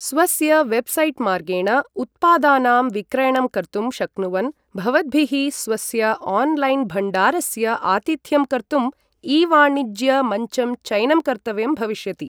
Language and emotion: Sanskrit, neutral